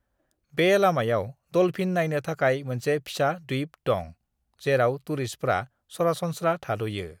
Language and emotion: Bodo, neutral